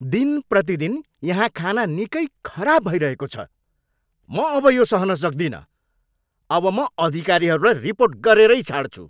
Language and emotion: Nepali, angry